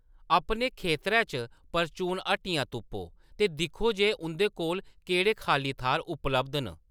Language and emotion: Dogri, neutral